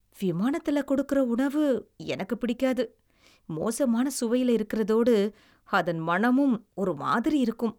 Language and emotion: Tamil, disgusted